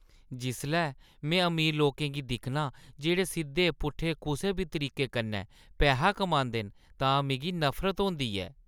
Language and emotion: Dogri, disgusted